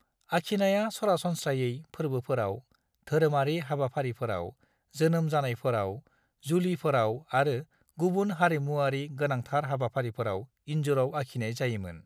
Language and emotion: Bodo, neutral